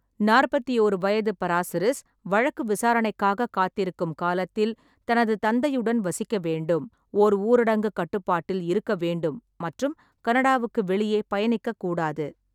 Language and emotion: Tamil, neutral